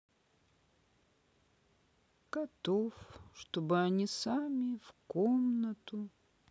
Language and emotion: Russian, sad